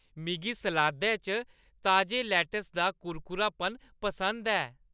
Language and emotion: Dogri, happy